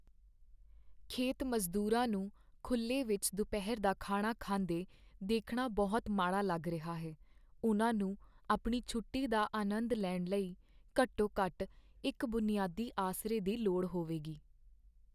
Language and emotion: Punjabi, sad